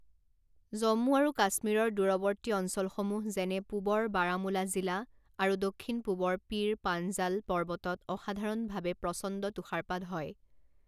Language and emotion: Assamese, neutral